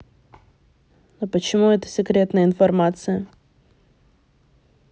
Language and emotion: Russian, neutral